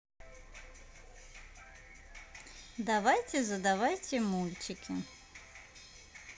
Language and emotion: Russian, neutral